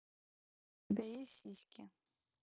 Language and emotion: Russian, neutral